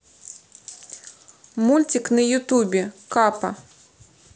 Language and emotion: Russian, neutral